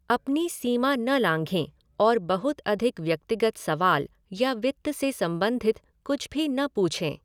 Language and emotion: Hindi, neutral